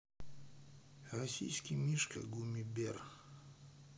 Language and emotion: Russian, neutral